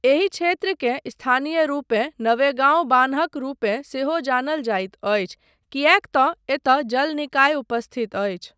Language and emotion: Maithili, neutral